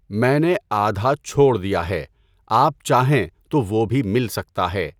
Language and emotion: Urdu, neutral